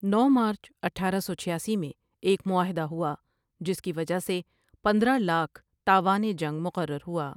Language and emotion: Urdu, neutral